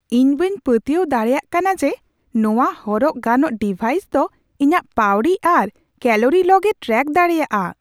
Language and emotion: Santali, surprised